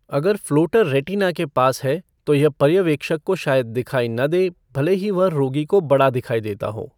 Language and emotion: Hindi, neutral